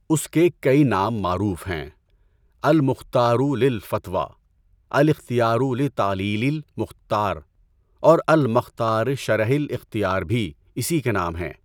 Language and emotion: Urdu, neutral